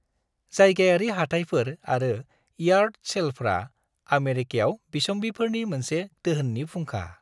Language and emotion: Bodo, happy